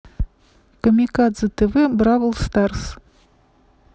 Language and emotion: Russian, neutral